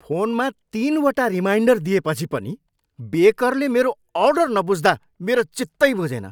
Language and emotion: Nepali, angry